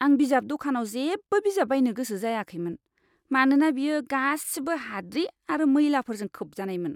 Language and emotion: Bodo, disgusted